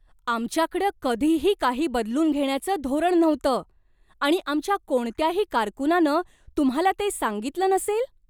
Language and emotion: Marathi, surprised